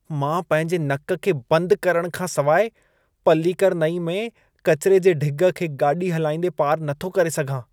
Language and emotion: Sindhi, disgusted